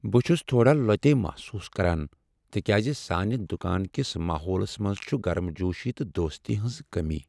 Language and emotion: Kashmiri, sad